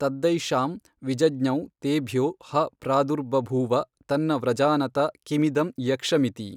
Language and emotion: Kannada, neutral